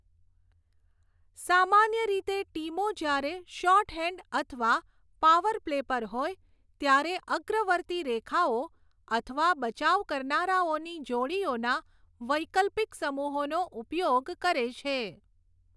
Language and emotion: Gujarati, neutral